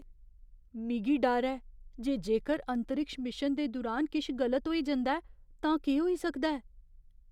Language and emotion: Dogri, fearful